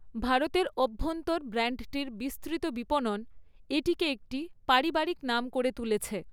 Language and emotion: Bengali, neutral